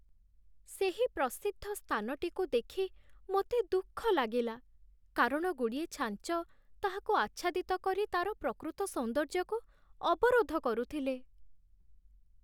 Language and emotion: Odia, sad